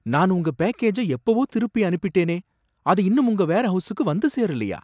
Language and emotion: Tamil, surprised